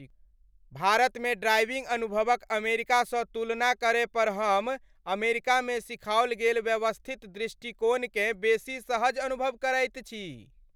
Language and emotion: Maithili, happy